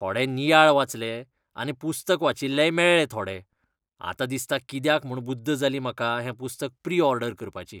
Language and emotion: Goan Konkani, disgusted